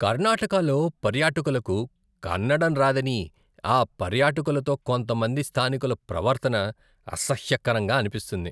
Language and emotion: Telugu, disgusted